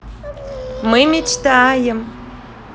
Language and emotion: Russian, positive